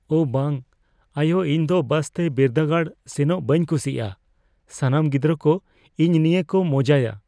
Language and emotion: Santali, fearful